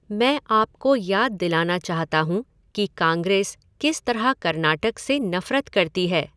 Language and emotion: Hindi, neutral